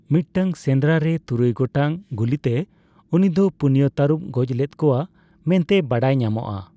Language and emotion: Santali, neutral